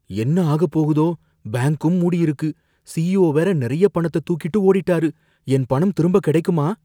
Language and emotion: Tamil, fearful